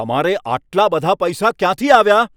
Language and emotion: Gujarati, angry